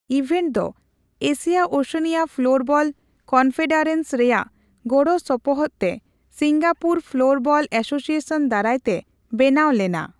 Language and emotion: Santali, neutral